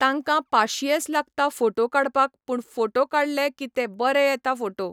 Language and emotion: Goan Konkani, neutral